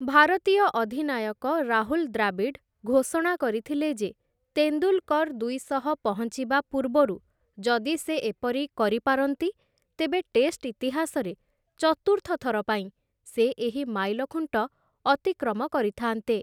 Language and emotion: Odia, neutral